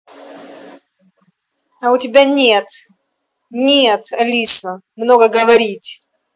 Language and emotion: Russian, angry